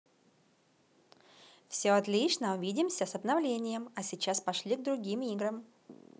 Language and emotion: Russian, positive